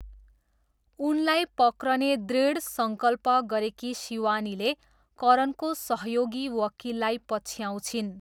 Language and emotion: Nepali, neutral